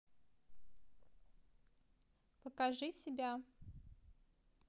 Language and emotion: Russian, neutral